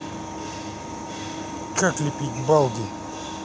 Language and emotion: Russian, neutral